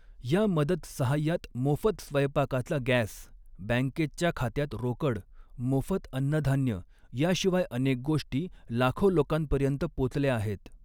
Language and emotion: Marathi, neutral